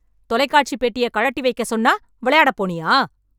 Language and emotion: Tamil, angry